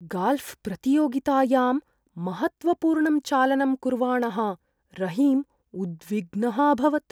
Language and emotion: Sanskrit, fearful